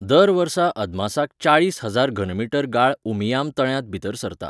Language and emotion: Goan Konkani, neutral